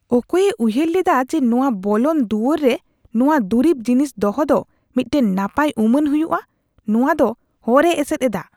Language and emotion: Santali, disgusted